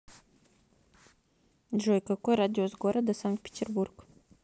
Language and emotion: Russian, neutral